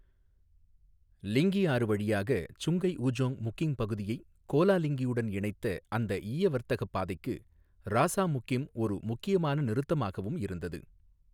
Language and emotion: Tamil, neutral